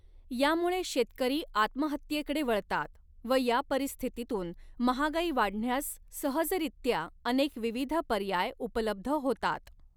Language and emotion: Marathi, neutral